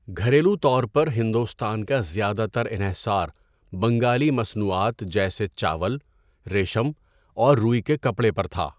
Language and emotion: Urdu, neutral